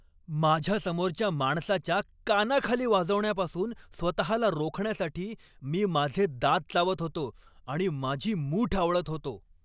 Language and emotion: Marathi, angry